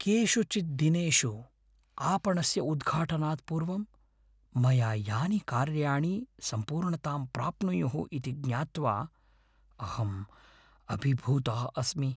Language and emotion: Sanskrit, fearful